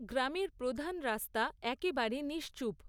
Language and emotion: Bengali, neutral